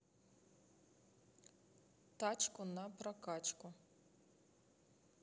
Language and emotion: Russian, neutral